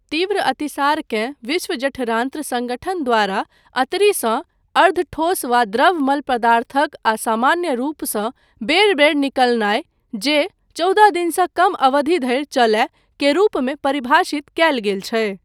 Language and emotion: Maithili, neutral